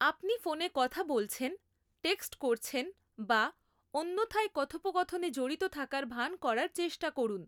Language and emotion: Bengali, neutral